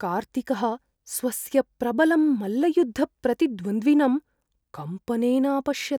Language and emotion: Sanskrit, fearful